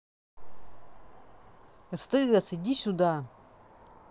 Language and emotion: Russian, angry